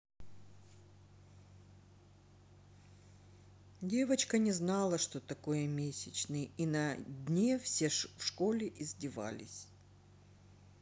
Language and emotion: Russian, neutral